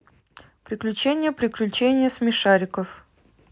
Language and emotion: Russian, neutral